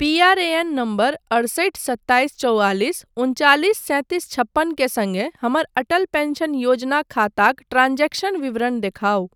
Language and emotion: Maithili, neutral